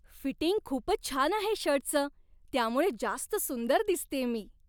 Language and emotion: Marathi, happy